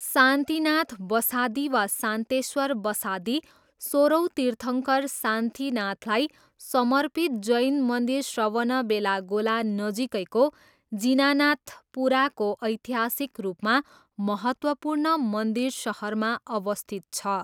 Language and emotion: Nepali, neutral